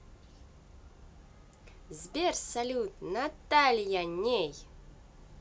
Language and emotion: Russian, positive